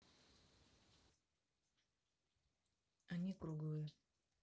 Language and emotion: Russian, neutral